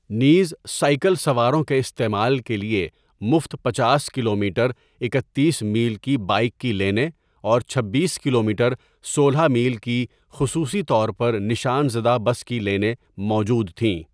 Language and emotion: Urdu, neutral